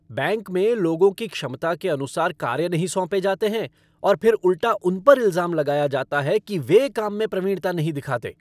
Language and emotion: Hindi, angry